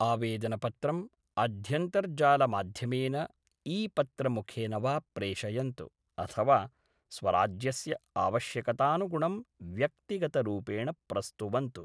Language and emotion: Sanskrit, neutral